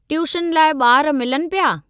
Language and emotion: Sindhi, neutral